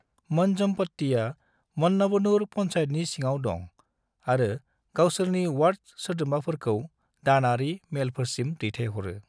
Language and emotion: Bodo, neutral